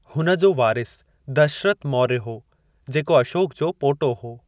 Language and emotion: Sindhi, neutral